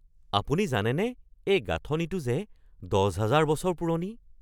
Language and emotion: Assamese, surprised